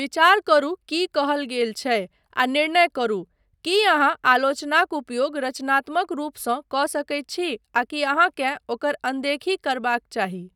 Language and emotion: Maithili, neutral